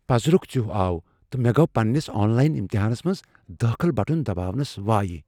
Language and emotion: Kashmiri, fearful